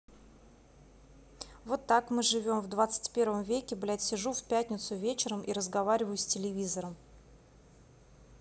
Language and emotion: Russian, angry